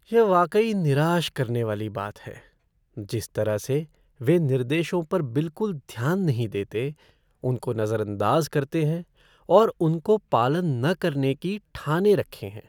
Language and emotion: Hindi, sad